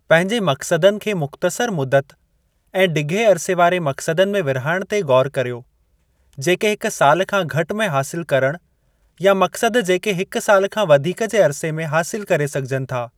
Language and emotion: Sindhi, neutral